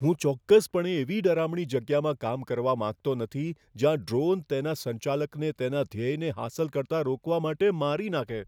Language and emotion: Gujarati, fearful